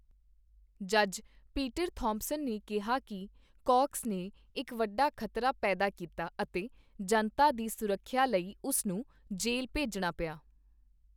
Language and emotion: Punjabi, neutral